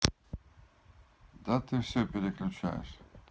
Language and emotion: Russian, neutral